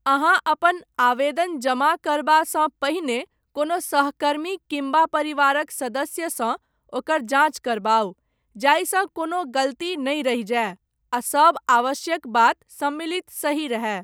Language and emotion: Maithili, neutral